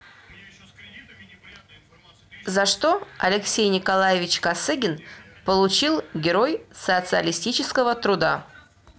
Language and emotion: Russian, neutral